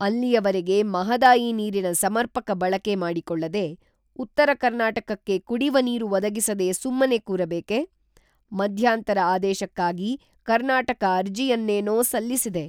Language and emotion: Kannada, neutral